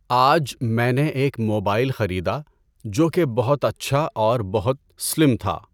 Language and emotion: Urdu, neutral